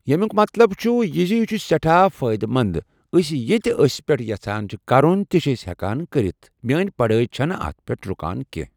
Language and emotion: Kashmiri, neutral